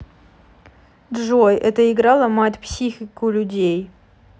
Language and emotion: Russian, sad